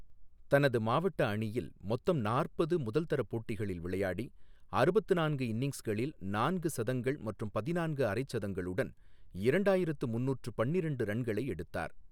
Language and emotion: Tamil, neutral